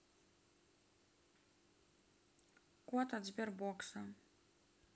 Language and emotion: Russian, neutral